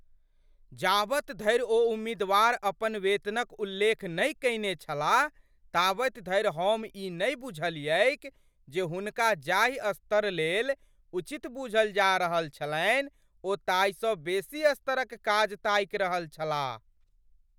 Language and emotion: Maithili, surprised